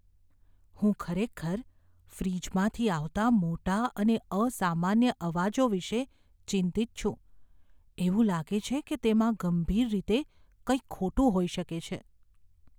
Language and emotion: Gujarati, fearful